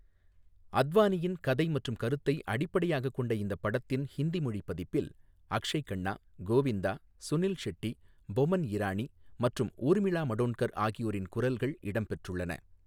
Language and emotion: Tamil, neutral